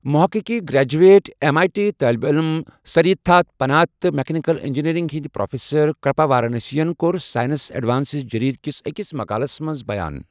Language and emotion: Kashmiri, neutral